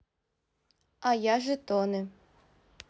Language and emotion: Russian, neutral